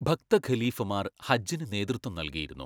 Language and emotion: Malayalam, neutral